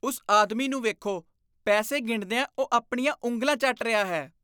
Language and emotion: Punjabi, disgusted